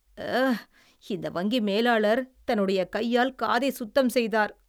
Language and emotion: Tamil, disgusted